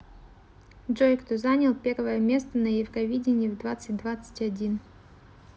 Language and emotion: Russian, neutral